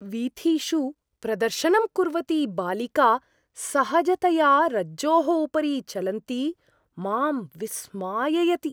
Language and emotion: Sanskrit, surprised